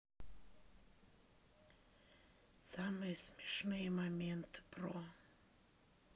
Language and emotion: Russian, sad